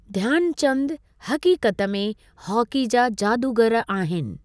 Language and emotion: Sindhi, neutral